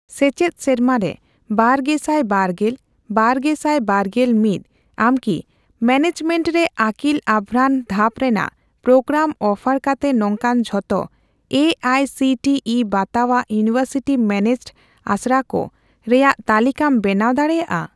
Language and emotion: Santali, neutral